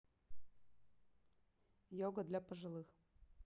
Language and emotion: Russian, neutral